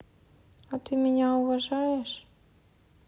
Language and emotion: Russian, sad